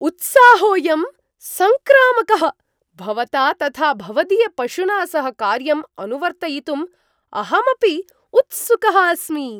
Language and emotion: Sanskrit, surprised